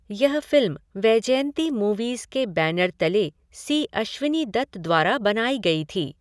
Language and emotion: Hindi, neutral